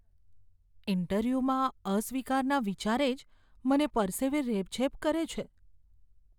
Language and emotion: Gujarati, fearful